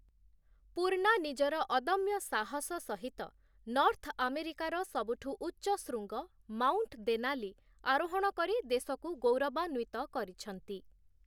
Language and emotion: Odia, neutral